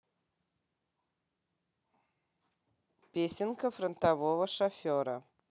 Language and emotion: Russian, neutral